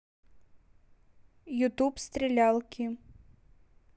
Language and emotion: Russian, neutral